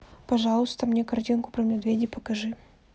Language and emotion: Russian, neutral